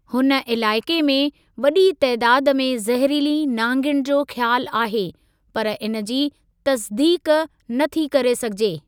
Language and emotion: Sindhi, neutral